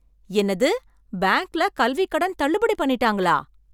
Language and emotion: Tamil, surprised